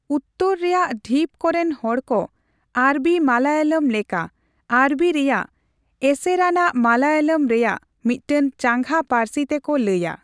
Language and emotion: Santali, neutral